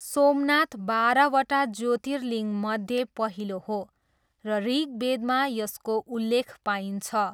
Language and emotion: Nepali, neutral